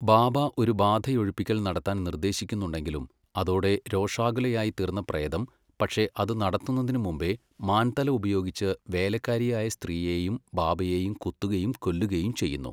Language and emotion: Malayalam, neutral